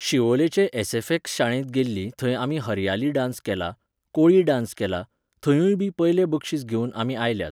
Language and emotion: Goan Konkani, neutral